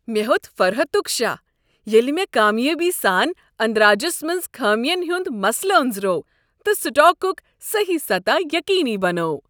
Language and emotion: Kashmiri, happy